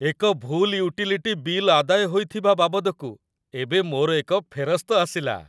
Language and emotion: Odia, happy